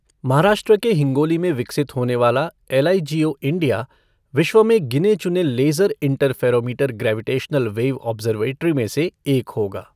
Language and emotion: Hindi, neutral